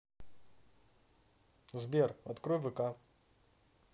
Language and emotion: Russian, neutral